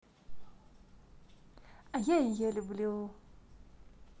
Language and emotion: Russian, positive